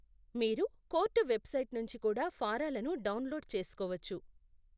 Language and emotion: Telugu, neutral